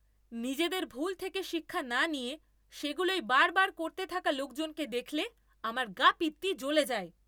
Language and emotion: Bengali, angry